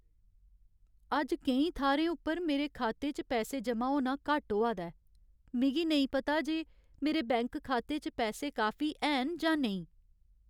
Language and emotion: Dogri, sad